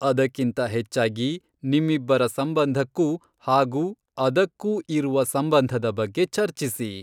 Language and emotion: Kannada, neutral